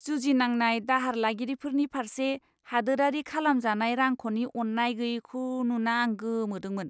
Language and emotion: Bodo, disgusted